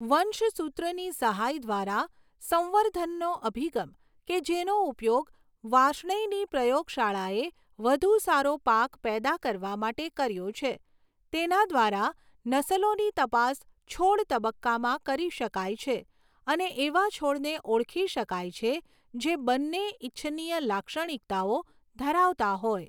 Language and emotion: Gujarati, neutral